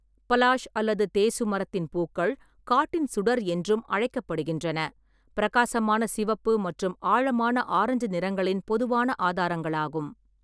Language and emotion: Tamil, neutral